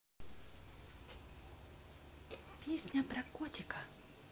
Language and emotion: Russian, neutral